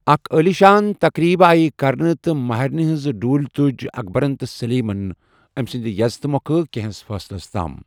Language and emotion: Kashmiri, neutral